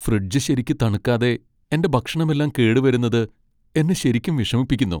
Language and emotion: Malayalam, sad